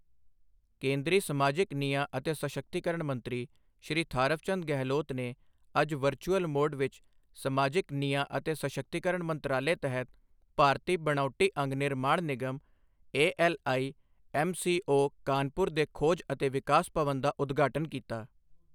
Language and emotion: Punjabi, neutral